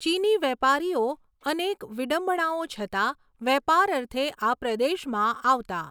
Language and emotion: Gujarati, neutral